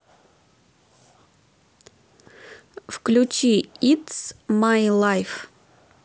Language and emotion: Russian, neutral